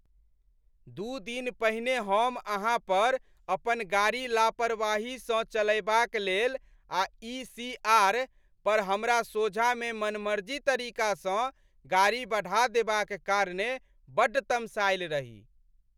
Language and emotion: Maithili, angry